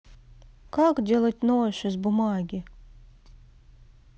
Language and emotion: Russian, neutral